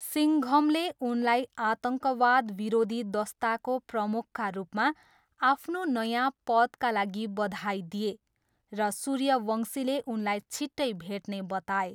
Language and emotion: Nepali, neutral